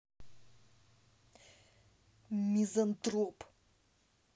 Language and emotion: Russian, angry